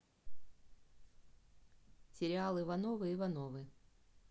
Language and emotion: Russian, neutral